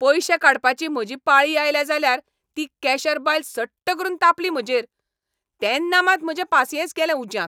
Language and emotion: Goan Konkani, angry